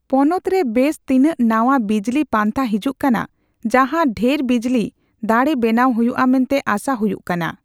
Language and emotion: Santali, neutral